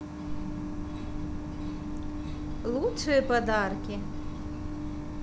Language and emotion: Russian, positive